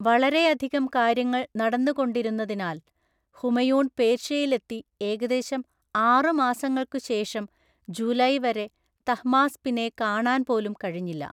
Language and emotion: Malayalam, neutral